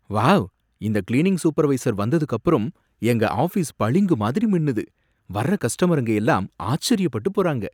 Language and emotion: Tamil, surprised